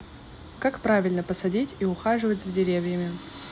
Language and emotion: Russian, neutral